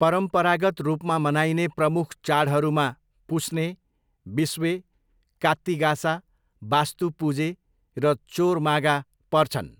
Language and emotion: Nepali, neutral